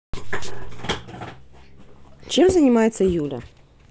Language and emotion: Russian, neutral